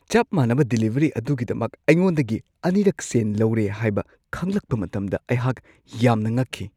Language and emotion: Manipuri, surprised